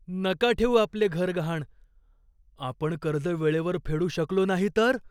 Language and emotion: Marathi, fearful